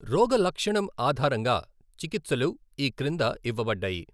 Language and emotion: Telugu, neutral